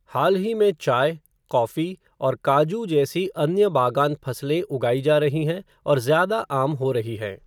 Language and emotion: Hindi, neutral